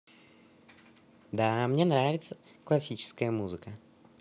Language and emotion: Russian, positive